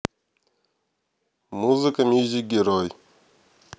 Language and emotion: Russian, neutral